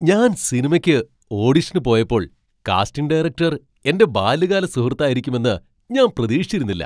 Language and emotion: Malayalam, surprised